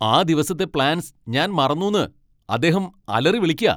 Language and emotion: Malayalam, angry